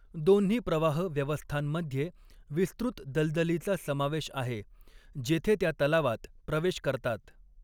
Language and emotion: Marathi, neutral